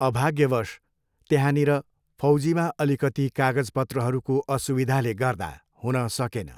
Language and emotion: Nepali, neutral